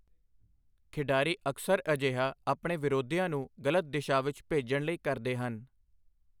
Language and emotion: Punjabi, neutral